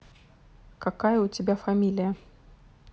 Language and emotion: Russian, neutral